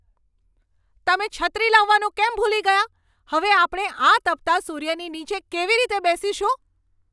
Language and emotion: Gujarati, angry